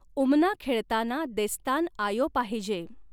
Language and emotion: Marathi, neutral